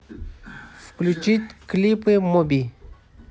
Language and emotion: Russian, neutral